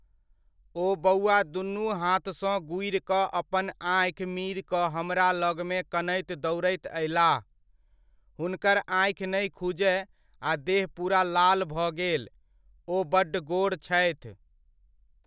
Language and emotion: Maithili, neutral